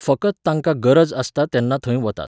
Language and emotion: Goan Konkani, neutral